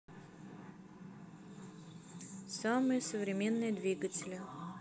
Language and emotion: Russian, neutral